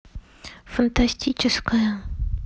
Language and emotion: Russian, neutral